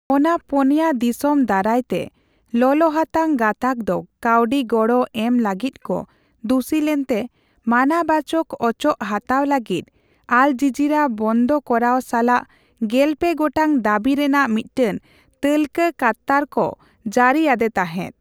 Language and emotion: Santali, neutral